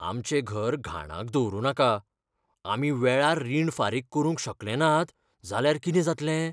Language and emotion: Goan Konkani, fearful